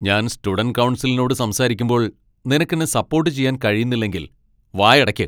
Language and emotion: Malayalam, angry